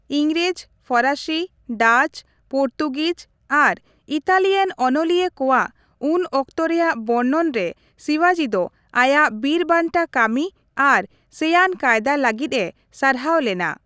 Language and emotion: Santali, neutral